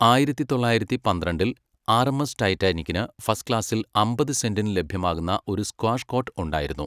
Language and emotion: Malayalam, neutral